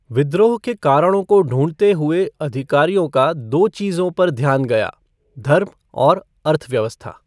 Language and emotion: Hindi, neutral